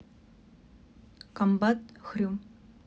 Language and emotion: Russian, neutral